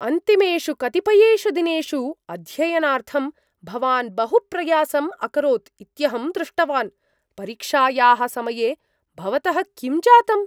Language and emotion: Sanskrit, surprised